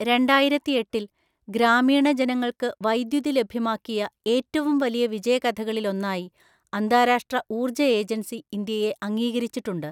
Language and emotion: Malayalam, neutral